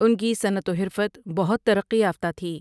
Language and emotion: Urdu, neutral